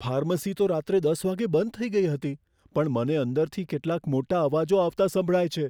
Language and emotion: Gujarati, fearful